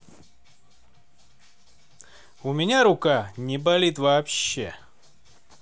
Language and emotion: Russian, neutral